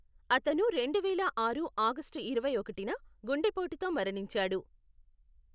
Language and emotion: Telugu, neutral